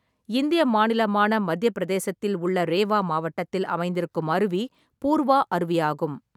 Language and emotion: Tamil, neutral